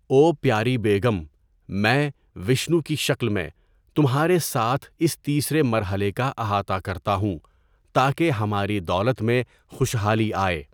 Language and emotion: Urdu, neutral